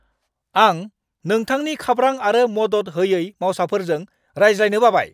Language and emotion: Bodo, angry